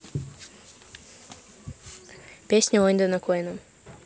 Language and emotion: Russian, neutral